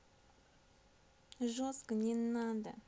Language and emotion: Russian, neutral